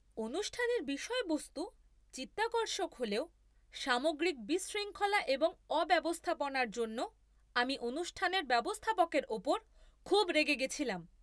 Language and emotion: Bengali, angry